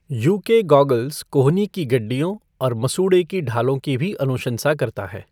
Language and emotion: Hindi, neutral